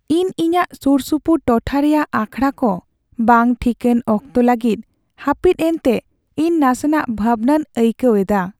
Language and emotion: Santali, sad